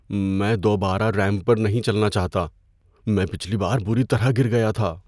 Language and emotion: Urdu, fearful